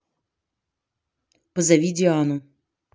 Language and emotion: Russian, neutral